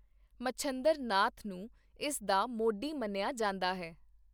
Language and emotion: Punjabi, neutral